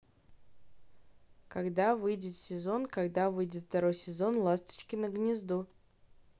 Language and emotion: Russian, neutral